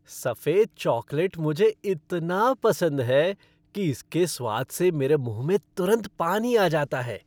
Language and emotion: Hindi, happy